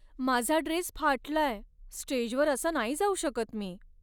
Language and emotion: Marathi, sad